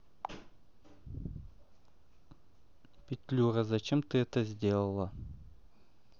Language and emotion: Russian, neutral